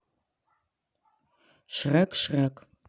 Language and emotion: Russian, neutral